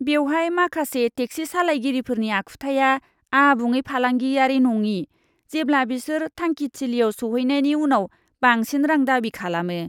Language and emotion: Bodo, disgusted